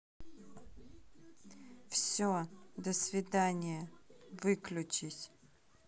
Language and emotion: Russian, neutral